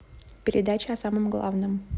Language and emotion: Russian, neutral